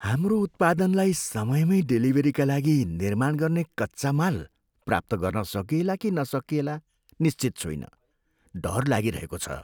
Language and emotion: Nepali, fearful